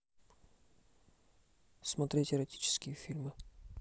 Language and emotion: Russian, neutral